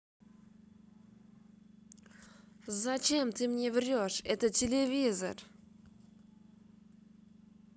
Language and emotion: Russian, angry